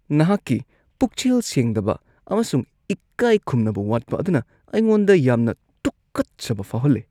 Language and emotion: Manipuri, disgusted